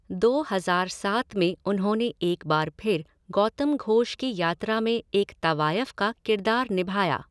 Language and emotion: Hindi, neutral